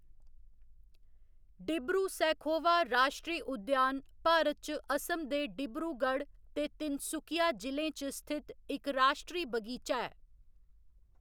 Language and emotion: Dogri, neutral